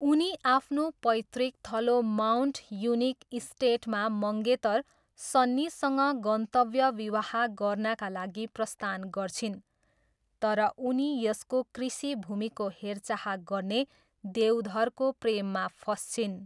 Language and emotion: Nepali, neutral